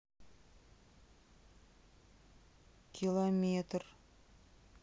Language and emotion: Russian, sad